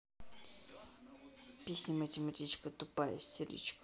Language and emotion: Russian, angry